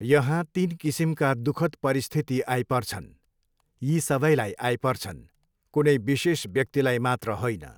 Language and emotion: Nepali, neutral